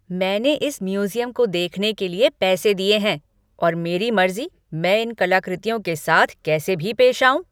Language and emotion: Hindi, angry